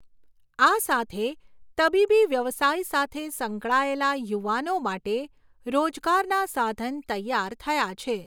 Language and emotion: Gujarati, neutral